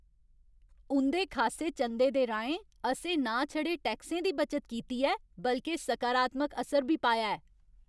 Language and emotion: Dogri, happy